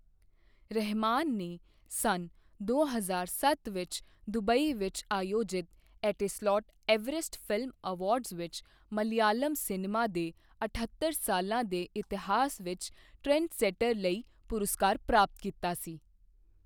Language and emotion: Punjabi, neutral